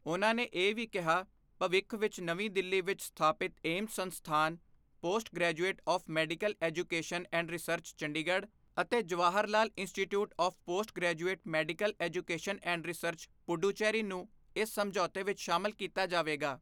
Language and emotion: Punjabi, neutral